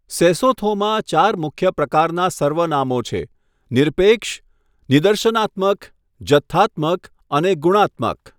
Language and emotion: Gujarati, neutral